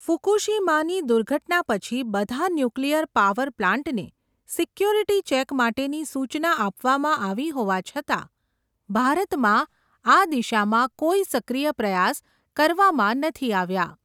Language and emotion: Gujarati, neutral